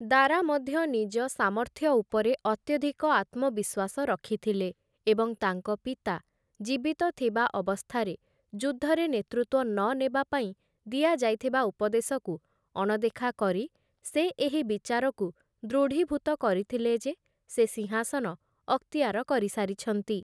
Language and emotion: Odia, neutral